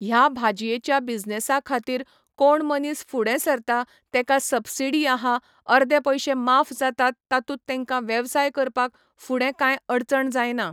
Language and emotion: Goan Konkani, neutral